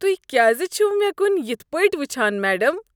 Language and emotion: Kashmiri, disgusted